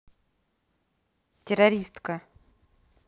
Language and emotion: Russian, angry